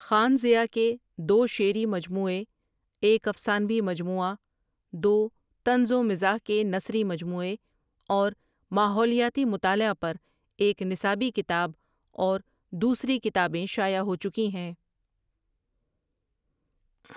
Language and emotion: Urdu, neutral